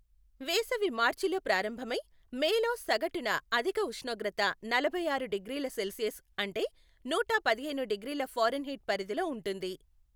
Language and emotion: Telugu, neutral